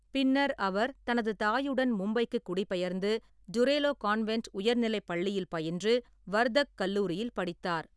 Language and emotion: Tamil, neutral